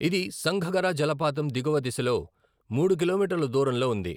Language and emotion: Telugu, neutral